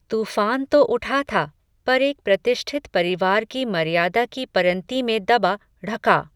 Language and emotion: Hindi, neutral